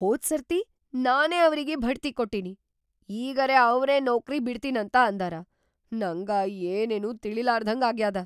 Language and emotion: Kannada, surprised